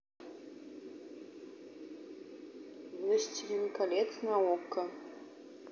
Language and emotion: Russian, neutral